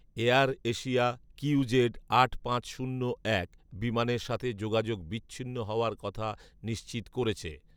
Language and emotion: Bengali, neutral